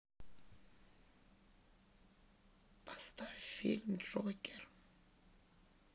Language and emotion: Russian, sad